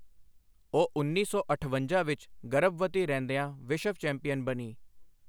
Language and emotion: Punjabi, neutral